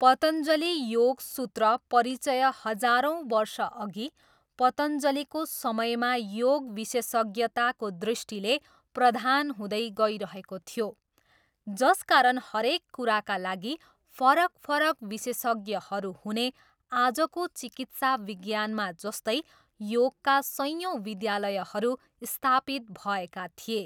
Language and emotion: Nepali, neutral